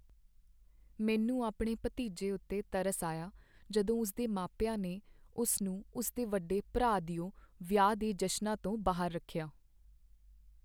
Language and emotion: Punjabi, sad